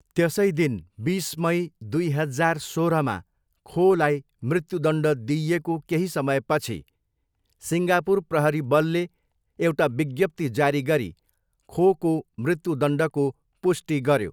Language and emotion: Nepali, neutral